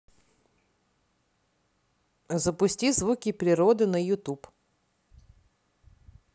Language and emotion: Russian, neutral